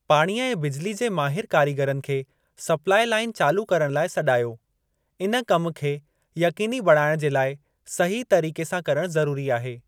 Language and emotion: Sindhi, neutral